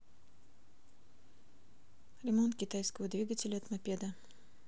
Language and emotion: Russian, neutral